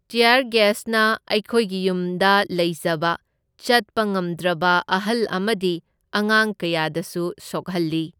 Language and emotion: Manipuri, neutral